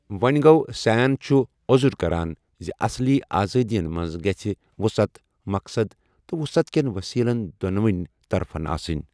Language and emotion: Kashmiri, neutral